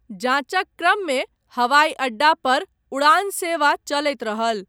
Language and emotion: Maithili, neutral